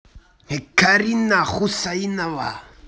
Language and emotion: Russian, angry